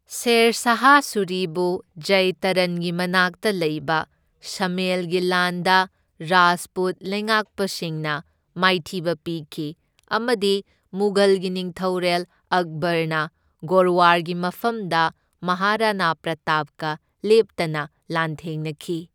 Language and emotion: Manipuri, neutral